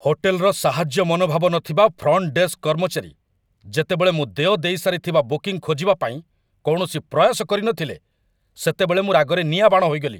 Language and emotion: Odia, angry